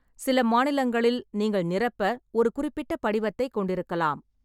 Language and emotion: Tamil, neutral